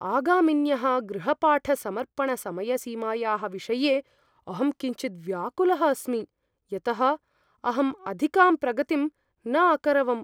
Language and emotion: Sanskrit, fearful